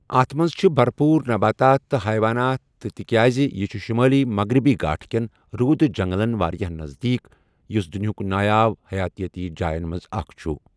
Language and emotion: Kashmiri, neutral